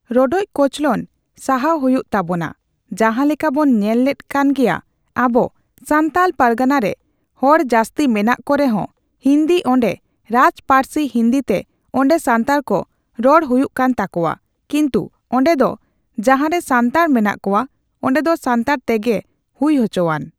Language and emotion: Santali, neutral